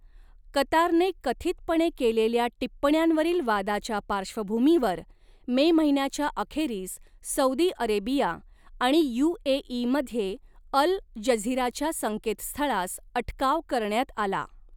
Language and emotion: Marathi, neutral